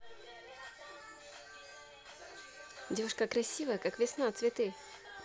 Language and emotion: Russian, positive